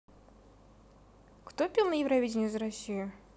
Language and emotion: Russian, neutral